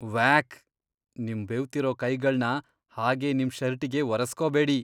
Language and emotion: Kannada, disgusted